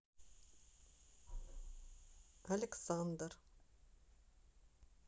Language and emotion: Russian, neutral